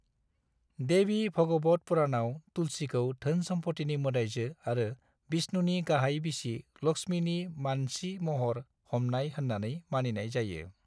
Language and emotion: Bodo, neutral